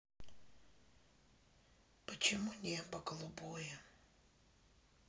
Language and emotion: Russian, sad